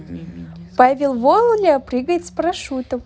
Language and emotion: Russian, positive